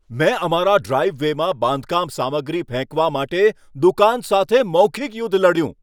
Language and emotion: Gujarati, angry